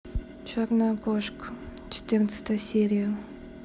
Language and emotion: Russian, neutral